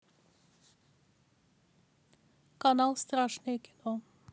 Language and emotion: Russian, neutral